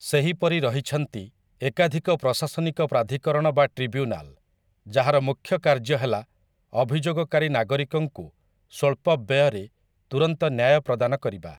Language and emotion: Odia, neutral